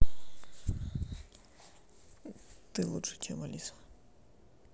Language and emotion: Russian, neutral